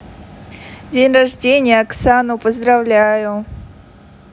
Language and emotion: Russian, positive